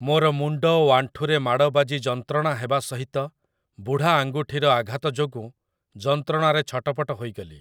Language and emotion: Odia, neutral